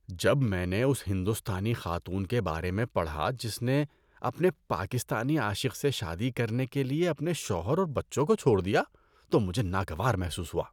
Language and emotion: Urdu, disgusted